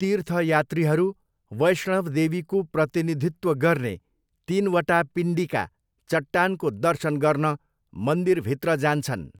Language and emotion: Nepali, neutral